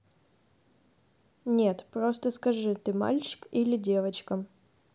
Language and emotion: Russian, neutral